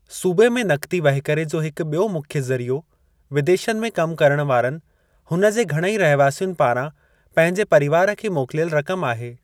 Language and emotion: Sindhi, neutral